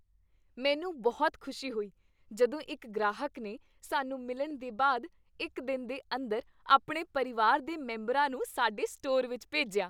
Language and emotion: Punjabi, happy